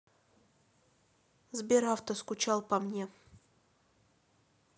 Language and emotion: Russian, neutral